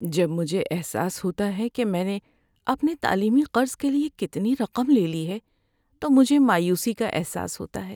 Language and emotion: Urdu, sad